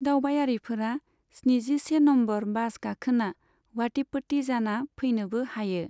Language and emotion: Bodo, neutral